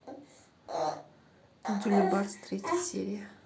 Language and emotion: Russian, neutral